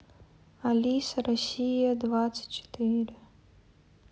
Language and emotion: Russian, sad